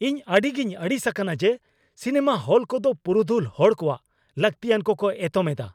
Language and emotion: Santali, angry